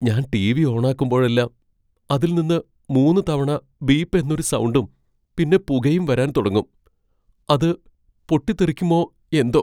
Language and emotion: Malayalam, fearful